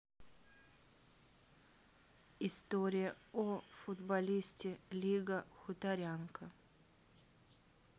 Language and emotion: Russian, neutral